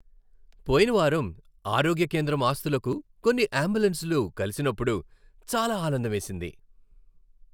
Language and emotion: Telugu, happy